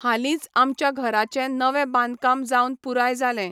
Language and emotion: Goan Konkani, neutral